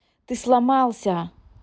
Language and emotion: Russian, neutral